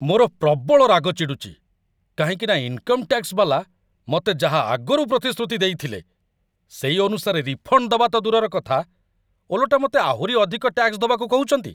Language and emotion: Odia, angry